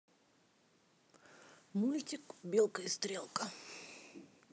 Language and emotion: Russian, neutral